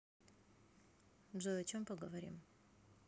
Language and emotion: Russian, neutral